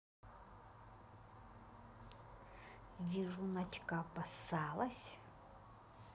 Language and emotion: Russian, neutral